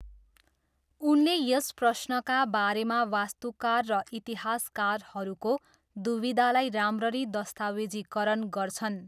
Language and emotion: Nepali, neutral